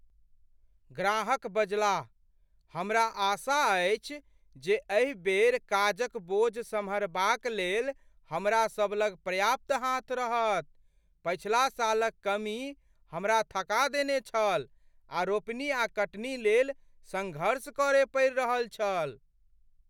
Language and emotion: Maithili, fearful